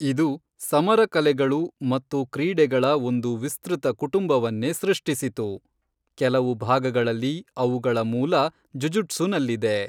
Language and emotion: Kannada, neutral